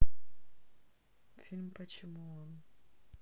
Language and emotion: Russian, neutral